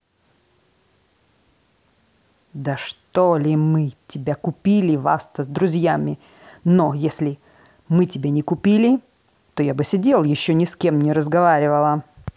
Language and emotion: Russian, angry